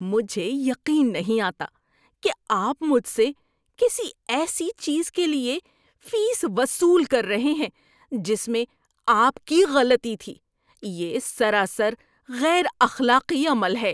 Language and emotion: Urdu, disgusted